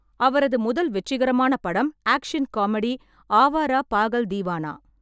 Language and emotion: Tamil, neutral